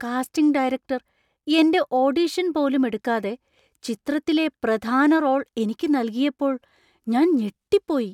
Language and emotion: Malayalam, surprised